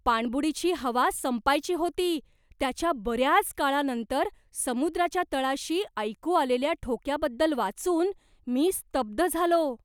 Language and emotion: Marathi, surprised